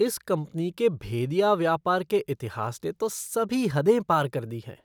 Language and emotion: Hindi, disgusted